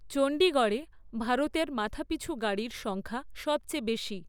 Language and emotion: Bengali, neutral